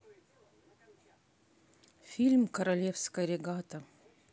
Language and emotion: Russian, neutral